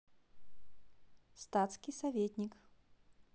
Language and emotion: Russian, neutral